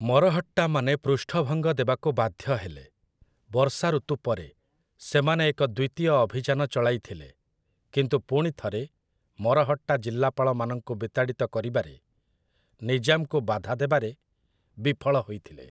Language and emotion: Odia, neutral